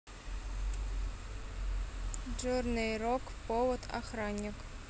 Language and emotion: Russian, neutral